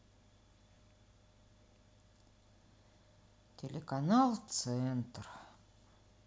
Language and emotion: Russian, sad